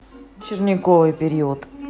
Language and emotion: Russian, neutral